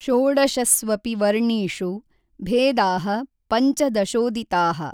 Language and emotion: Kannada, neutral